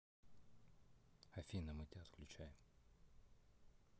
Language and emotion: Russian, neutral